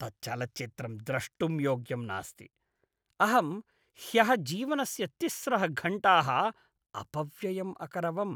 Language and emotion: Sanskrit, disgusted